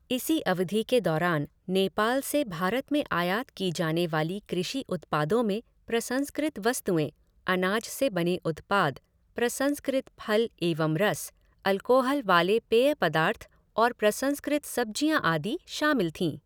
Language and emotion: Hindi, neutral